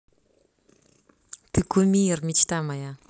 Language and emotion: Russian, neutral